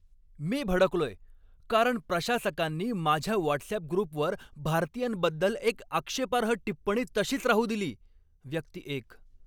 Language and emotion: Marathi, angry